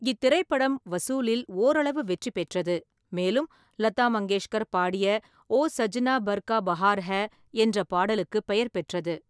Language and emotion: Tamil, neutral